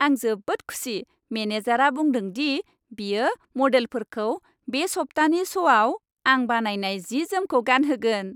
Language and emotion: Bodo, happy